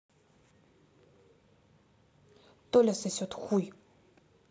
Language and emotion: Russian, angry